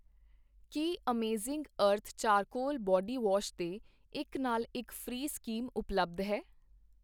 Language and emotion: Punjabi, neutral